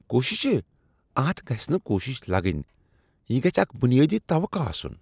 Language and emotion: Kashmiri, disgusted